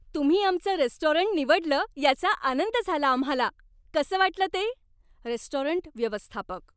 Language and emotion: Marathi, happy